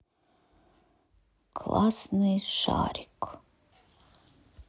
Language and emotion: Russian, sad